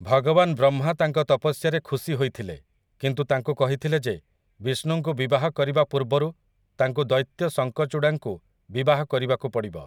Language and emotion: Odia, neutral